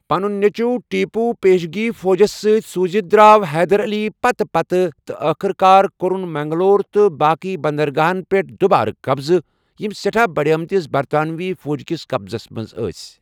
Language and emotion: Kashmiri, neutral